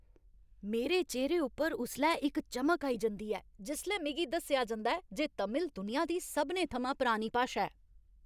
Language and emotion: Dogri, happy